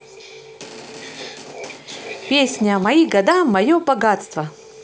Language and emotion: Russian, positive